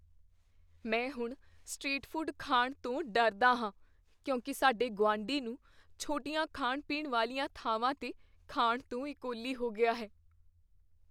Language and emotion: Punjabi, fearful